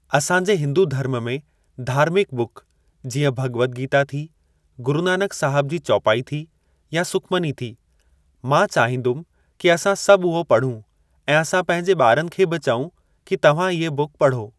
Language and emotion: Sindhi, neutral